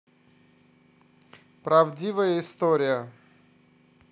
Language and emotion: Russian, neutral